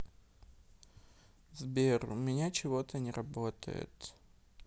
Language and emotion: Russian, sad